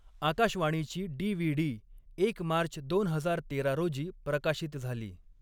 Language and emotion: Marathi, neutral